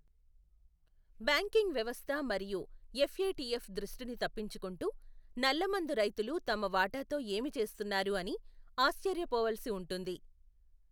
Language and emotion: Telugu, neutral